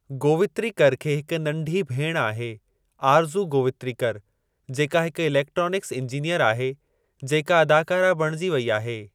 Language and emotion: Sindhi, neutral